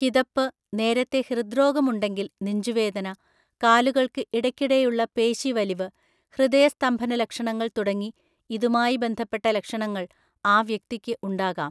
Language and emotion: Malayalam, neutral